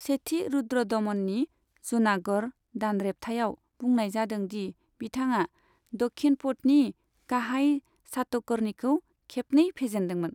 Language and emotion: Bodo, neutral